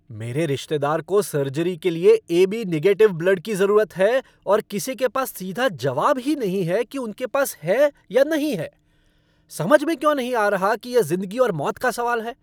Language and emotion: Hindi, angry